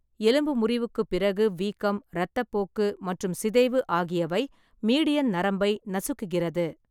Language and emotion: Tamil, neutral